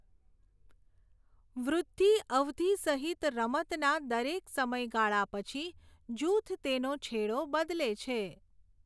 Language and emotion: Gujarati, neutral